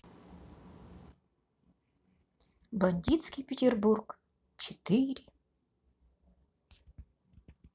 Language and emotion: Russian, positive